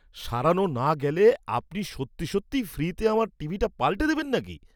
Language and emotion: Bengali, surprised